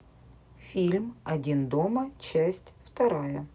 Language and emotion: Russian, neutral